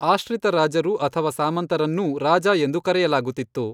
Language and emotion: Kannada, neutral